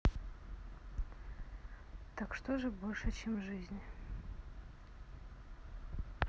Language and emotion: Russian, sad